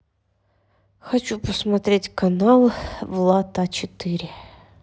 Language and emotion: Russian, neutral